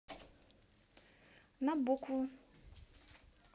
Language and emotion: Russian, neutral